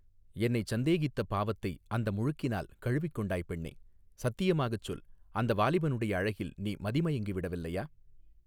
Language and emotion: Tamil, neutral